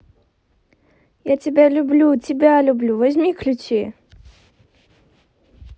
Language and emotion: Russian, positive